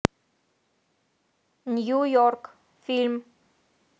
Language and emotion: Russian, neutral